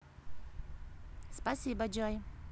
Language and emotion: Russian, positive